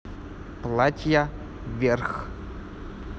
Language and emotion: Russian, neutral